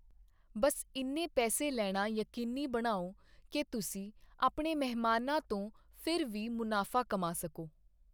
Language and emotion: Punjabi, neutral